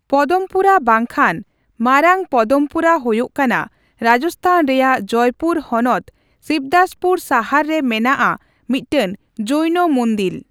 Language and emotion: Santali, neutral